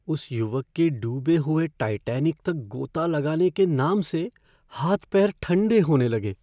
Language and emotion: Hindi, fearful